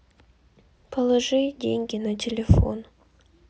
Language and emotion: Russian, sad